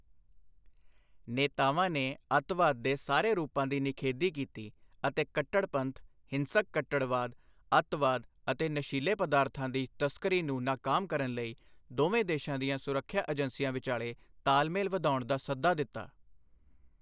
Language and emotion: Punjabi, neutral